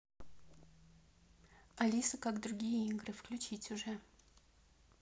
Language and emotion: Russian, neutral